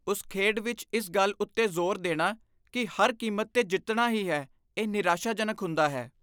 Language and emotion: Punjabi, disgusted